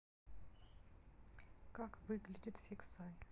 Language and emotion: Russian, neutral